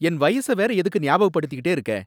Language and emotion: Tamil, angry